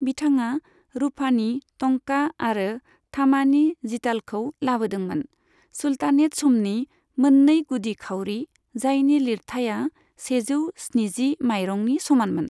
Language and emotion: Bodo, neutral